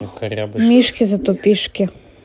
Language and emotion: Russian, neutral